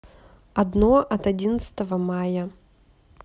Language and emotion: Russian, neutral